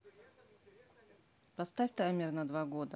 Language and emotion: Russian, neutral